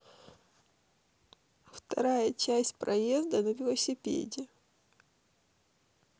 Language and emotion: Russian, sad